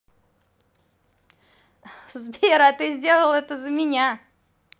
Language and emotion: Russian, positive